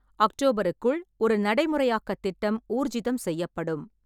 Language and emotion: Tamil, neutral